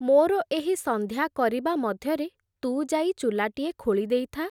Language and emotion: Odia, neutral